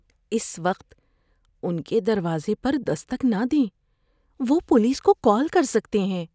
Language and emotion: Urdu, fearful